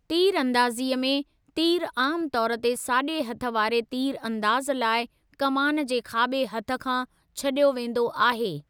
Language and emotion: Sindhi, neutral